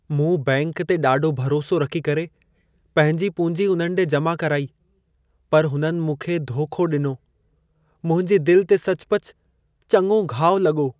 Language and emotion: Sindhi, sad